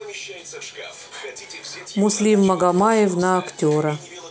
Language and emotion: Russian, neutral